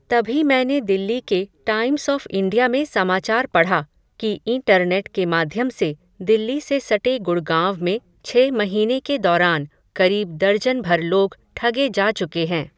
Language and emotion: Hindi, neutral